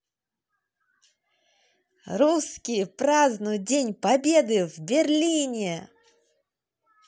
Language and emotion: Russian, positive